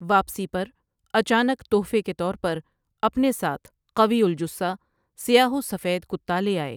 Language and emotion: Urdu, neutral